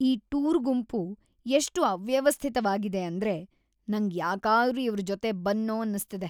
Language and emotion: Kannada, disgusted